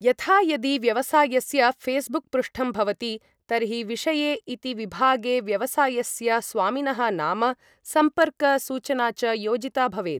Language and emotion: Sanskrit, neutral